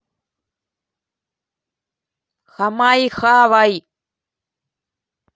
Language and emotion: Russian, angry